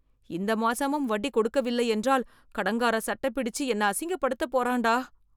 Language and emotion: Tamil, fearful